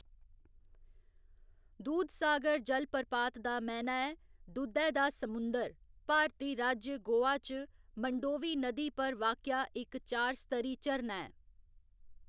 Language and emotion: Dogri, neutral